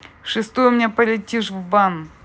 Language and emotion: Russian, angry